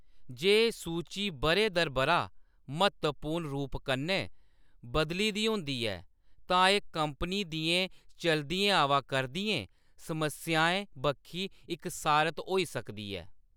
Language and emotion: Dogri, neutral